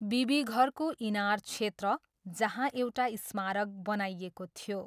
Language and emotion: Nepali, neutral